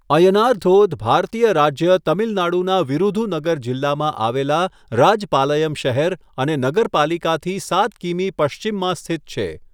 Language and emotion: Gujarati, neutral